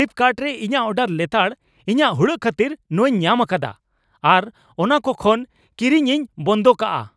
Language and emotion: Santali, angry